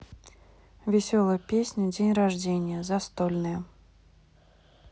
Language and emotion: Russian, neutral